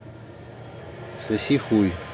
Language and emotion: Russian, neutral